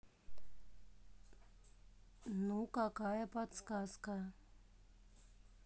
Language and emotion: Russian, neutral